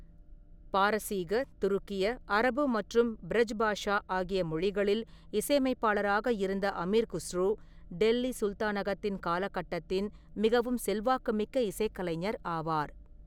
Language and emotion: Tamil, neutral